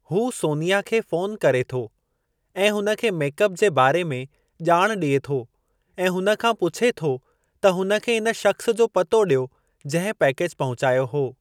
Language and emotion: Sindhi, neutral